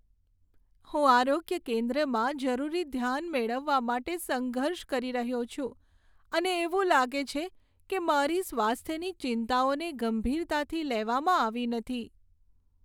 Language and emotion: Gujarati, sad